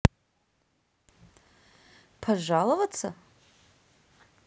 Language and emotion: Russian, neutral